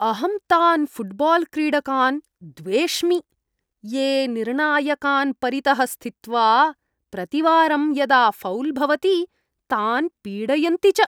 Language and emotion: Sanskrit, disgusted